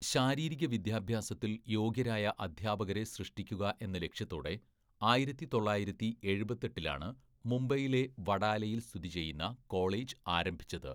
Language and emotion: Malayalam, neutral